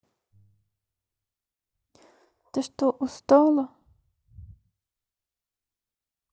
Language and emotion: Russian, neutral